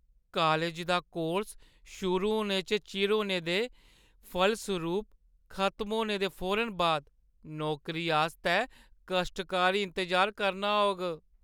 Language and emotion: Dogri, sad